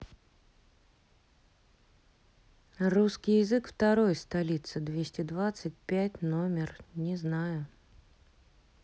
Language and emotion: Russian, neutral